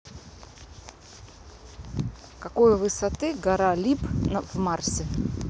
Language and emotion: Russian, neutral